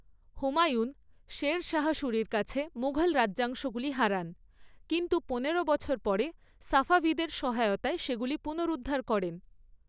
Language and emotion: Bengali, neutral